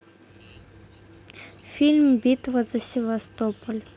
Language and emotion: Russian, neutral